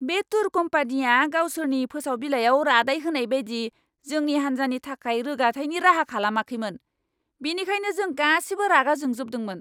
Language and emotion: Bodo, angry